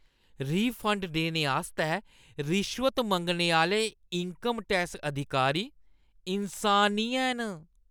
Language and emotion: Dogri, disgusted